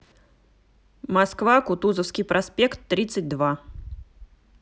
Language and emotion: Russian, neutral